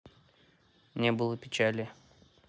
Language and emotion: Russian, neutral